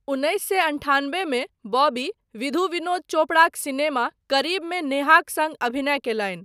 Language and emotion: Maithili, neutral